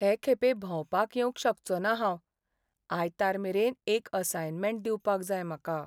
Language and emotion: Goan Konkani, sad